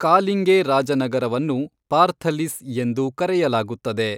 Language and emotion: Kannada, neutral